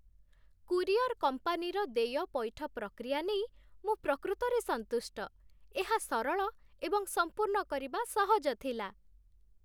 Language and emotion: Odia, happy